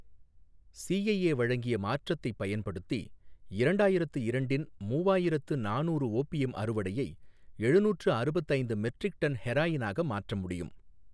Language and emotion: Tamil, neutral